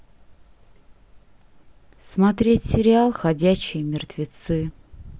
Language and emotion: Russian, sad